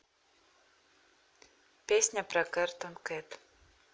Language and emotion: Russian, neutral